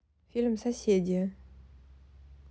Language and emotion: Russian, neutral